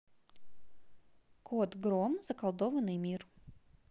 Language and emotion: Russian, neutral